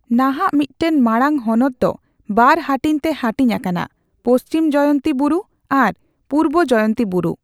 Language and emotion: Santali, neutral